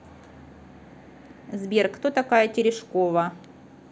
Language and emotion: Russian, neutral